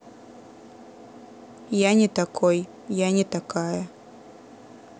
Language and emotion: Russian, neutral